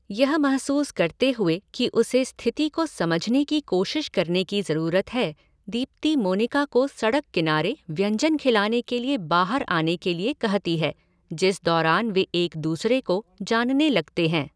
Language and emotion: Hindi, neutral